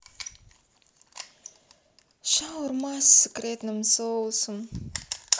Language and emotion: Russian, sad